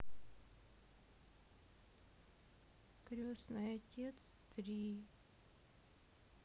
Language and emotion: Russian, sad